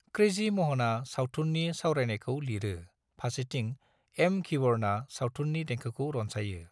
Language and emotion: Bodo, neutral